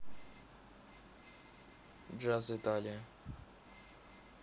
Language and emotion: Russian, neutral